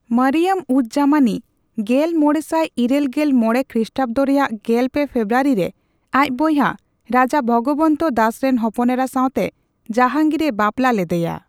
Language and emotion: Santali, neutral